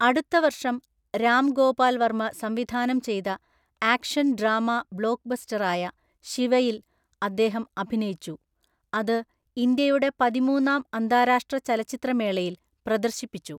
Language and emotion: Malayalam, neutral